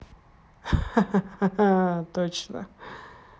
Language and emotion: Russian, positive